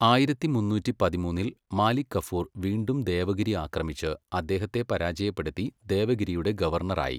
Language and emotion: Malayalam, neutral